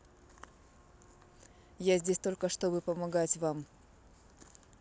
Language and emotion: Russian, neutral